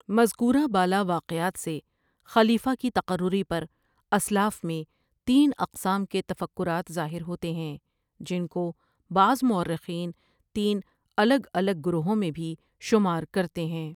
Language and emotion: Urdu, neutral